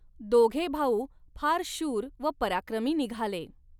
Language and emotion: Marathi, neutral